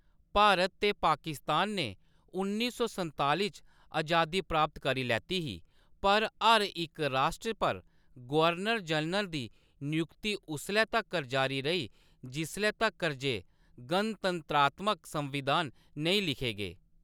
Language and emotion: Dogri, neutral